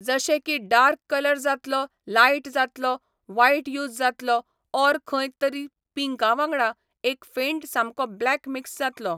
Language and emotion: Goan Konkani, neutral